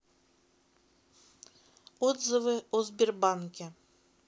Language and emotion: Russian, neutral